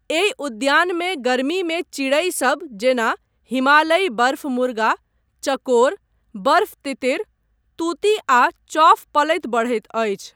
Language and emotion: Maithili, neutral